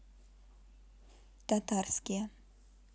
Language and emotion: Russian, neutral